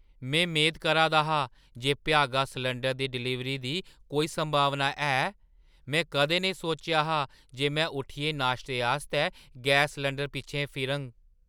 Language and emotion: Dogri, surprised